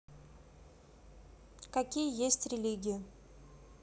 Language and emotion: Russian, neutral